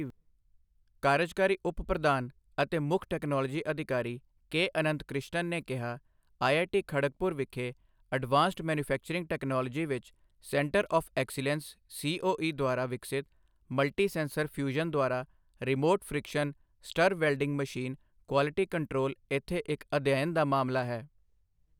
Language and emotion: Punjabi, neutral